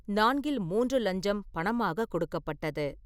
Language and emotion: Tamil, neutral